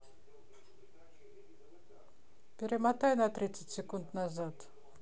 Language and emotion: Russian, neutral